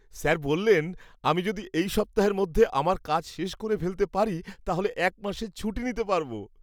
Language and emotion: Bengali, happy